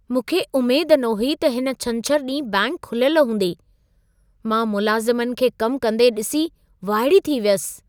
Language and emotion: Sindhi, surprised